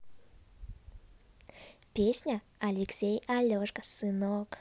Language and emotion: Russian, positive